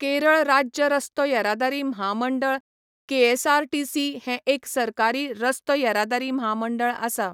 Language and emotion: Goan Konkani, neutral